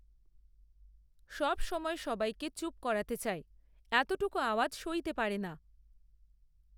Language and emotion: Bengali, neutral